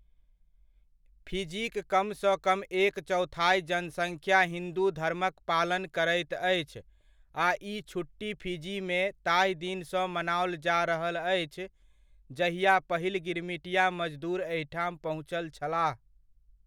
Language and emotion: Maithili, neutral